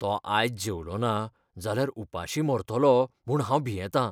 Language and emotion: Goan Konkani, fearful